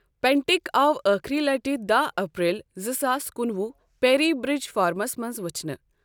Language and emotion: Kashmiri, neutral